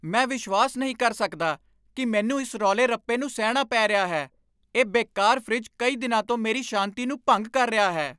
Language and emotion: Punjabi, angry